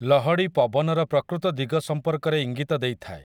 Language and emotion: Odia, neutral